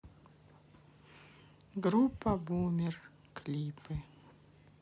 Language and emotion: Russian, neutral